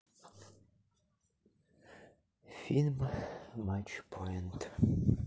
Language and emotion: Russian, sad